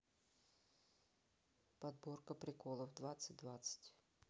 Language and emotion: Russian, neutral